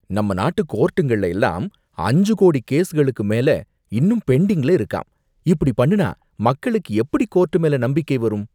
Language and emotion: Tamil, disgusted